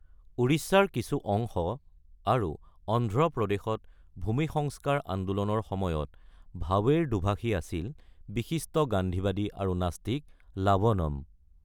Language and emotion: Assamese, neutral